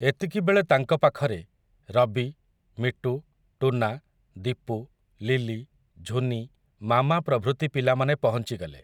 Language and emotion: Odia, neutral